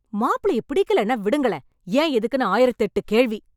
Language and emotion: Tamil, angry